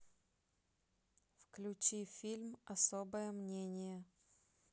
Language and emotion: Russian, neutral